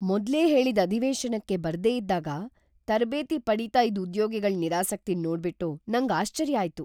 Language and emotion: Kannada, surprised